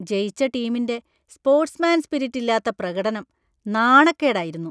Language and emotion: Malayalam, disgusted